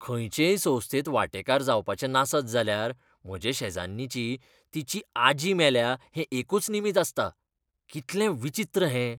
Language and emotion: Goan Konkani, disgusted